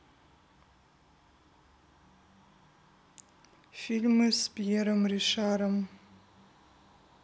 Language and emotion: Russian, neutral